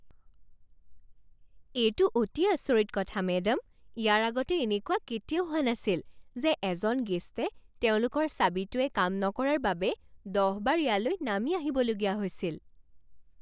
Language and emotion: Assamese, surprised